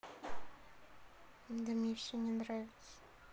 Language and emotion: Russian, sad